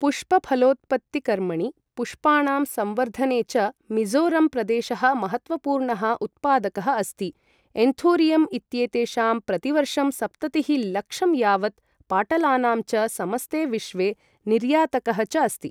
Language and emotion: Sanskrit, neutral